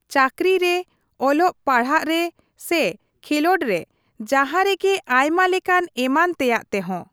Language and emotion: Santali, neutral